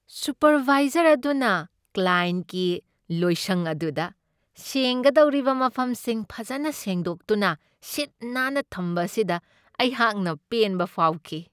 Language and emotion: Manipuri, happy